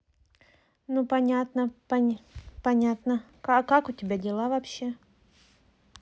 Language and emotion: Russian, neutral